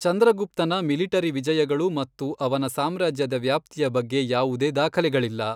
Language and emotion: Kannada, neutral